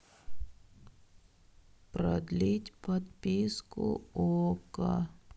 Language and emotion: Russian, sad